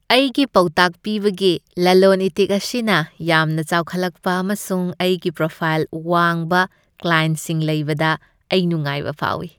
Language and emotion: Manipuri, happy